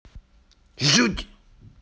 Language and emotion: Russian, angry